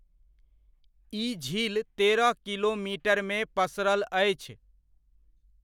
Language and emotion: Maithili, neutral